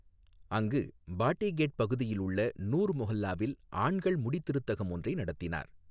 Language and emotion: Tamil, neutral